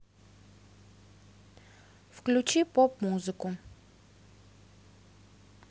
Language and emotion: Russian, neutral